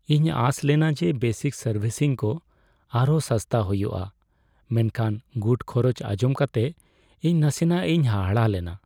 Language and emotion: Santali, sad